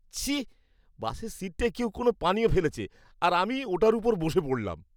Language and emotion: Bengali, disgusted